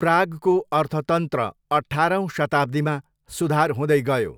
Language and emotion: Nepali, neutral